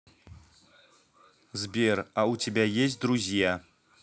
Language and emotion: Russian, neutral